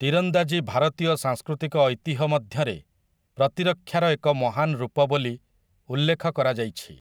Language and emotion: Odia, neutral